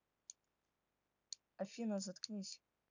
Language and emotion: Russian, neutral